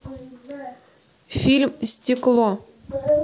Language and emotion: Russian, neutral